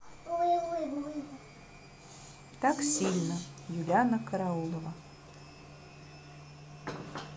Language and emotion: Russian, neutral